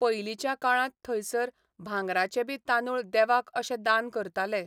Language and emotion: Goan Konkani, neutral